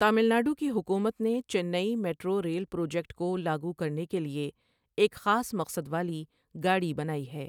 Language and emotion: Urdu, neutral